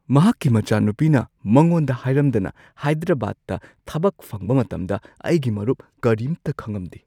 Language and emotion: Manipuri, surprised